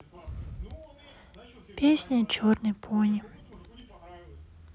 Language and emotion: Russian, sad